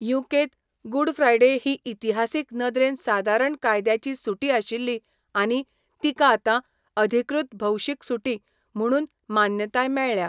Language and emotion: Goan Konkani, neutral